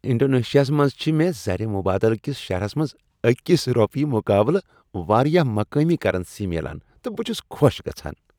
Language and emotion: Kashmiri, happy